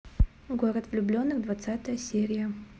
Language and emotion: Russian, neutral